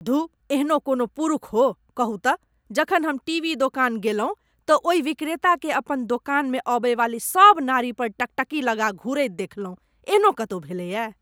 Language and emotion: Maithili, disgusted